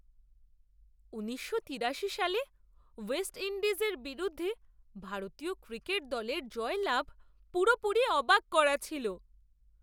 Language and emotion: Bengali, surprised